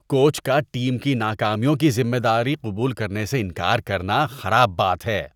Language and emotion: Urdu, disgusted